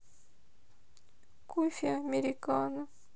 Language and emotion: Russian, sad